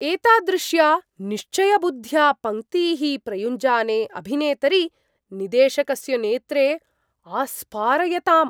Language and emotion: Sanskrit, surprised